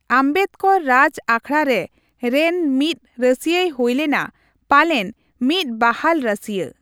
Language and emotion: Santali, neutral